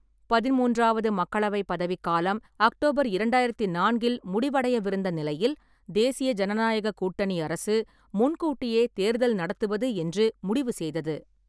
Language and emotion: Tamil, neutral